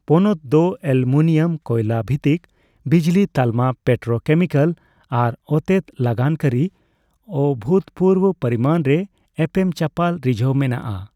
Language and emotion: Santali, neutral